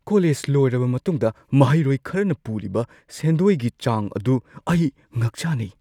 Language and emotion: Manipuri, surprised